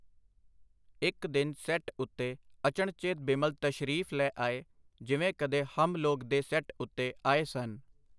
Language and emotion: Punjabi, neutral